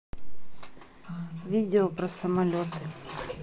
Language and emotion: Russian, neutral